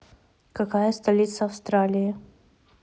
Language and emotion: Russian, neutral